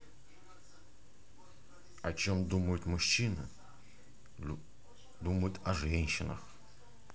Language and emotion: Russian, positive